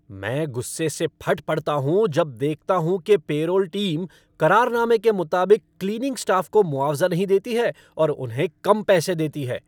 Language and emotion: Hindi, angry